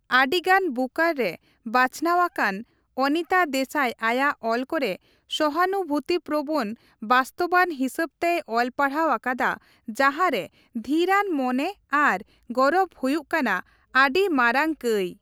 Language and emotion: Santali, neutral